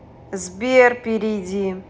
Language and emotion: Russian, neutral